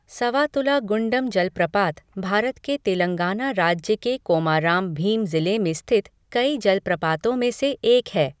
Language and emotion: Hindi, neutral